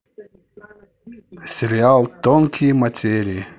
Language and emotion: Russian, neutral